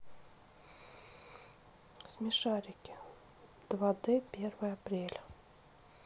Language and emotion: Russian, neutral